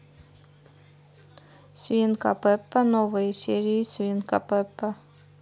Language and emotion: Russian, neutral